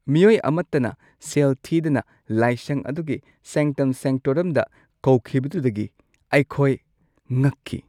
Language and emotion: Manipuri, surprised